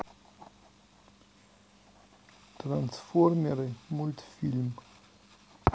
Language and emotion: Russian, neutral